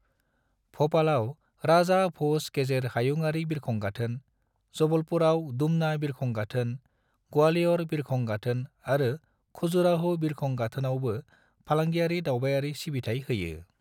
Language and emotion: Bodo, neutral